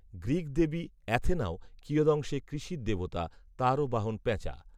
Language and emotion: Bengali, neutral